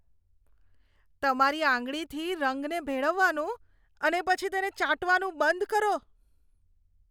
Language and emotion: Gujarati, disgusted